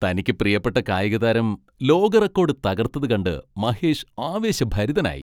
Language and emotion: Malayalam, happy